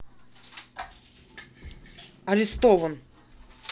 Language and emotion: Russian, angry